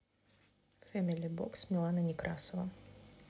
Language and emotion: Russian, neutral